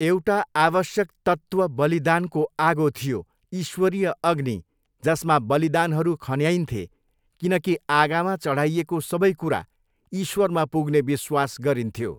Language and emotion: Nepali, neutral